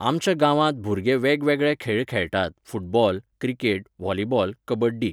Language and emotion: Goan Konkani, neutral